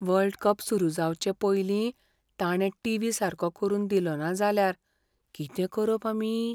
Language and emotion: Goan Konkani, fearful